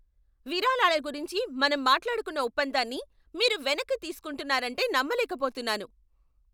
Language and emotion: Telugu, angry